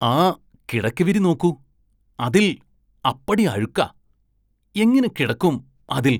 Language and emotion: Malayalam, disgusted